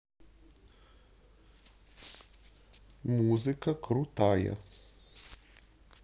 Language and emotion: Russian, neutral